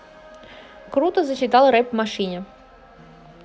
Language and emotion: Russian, positive